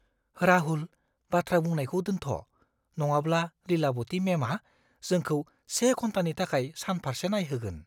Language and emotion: Bodo, fearful